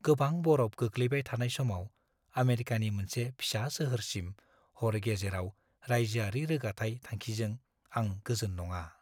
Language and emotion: Bodo, fearful